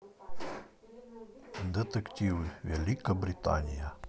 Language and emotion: Russian, neutral